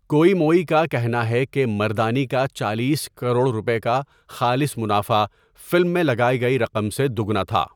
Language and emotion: Urdu, neutral